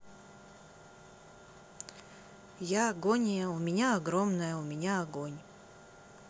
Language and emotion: Russian, neutral